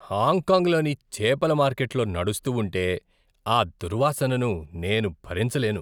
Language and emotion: Telugu, disgusted